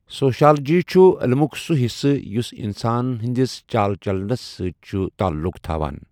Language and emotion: Kashmiri, neutral